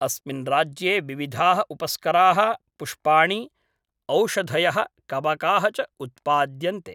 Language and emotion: Sanskrit, neutral